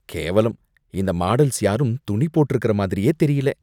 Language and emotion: Tamil, disgusted